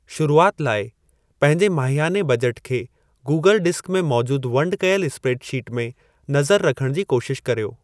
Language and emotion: Sindhi, neutral